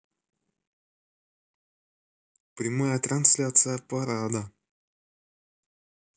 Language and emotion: Russian, neutral